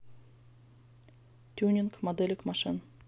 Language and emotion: Russian, neutral